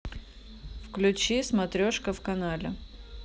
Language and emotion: Russian, neutral